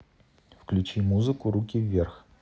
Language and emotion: Russian, neutral